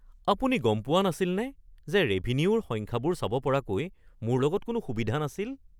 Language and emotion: Assamese, surprised